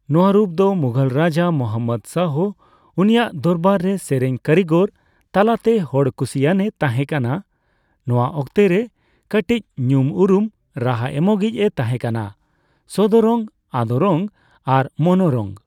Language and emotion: Santali, neutral